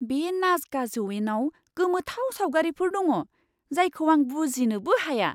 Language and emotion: Bodo, surprised